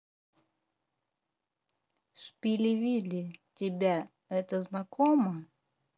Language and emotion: Russian, neutral